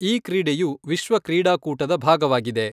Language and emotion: Kannada, neutral